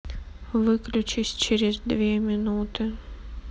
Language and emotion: Russian, sad